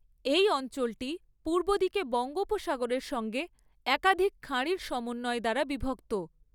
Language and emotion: Bengali, neutral